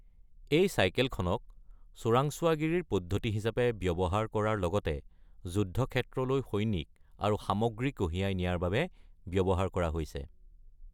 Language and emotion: Assamese, neutral